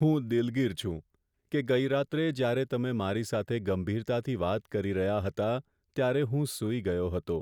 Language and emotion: Gujarati, sad